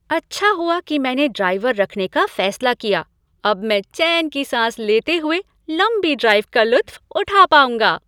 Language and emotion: Hindi, happy